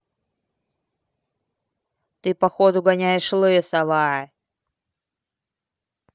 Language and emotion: Russian, angry